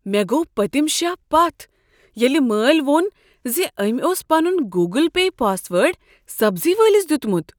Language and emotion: Kashmiri, surprised